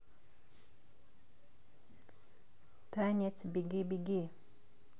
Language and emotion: Russian, neutral